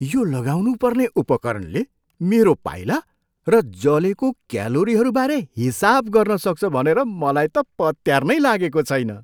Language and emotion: Nepali, surprised